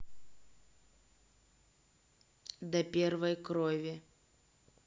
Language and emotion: Russian, neutral